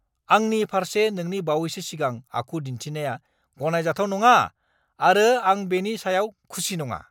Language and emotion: Bodo, angry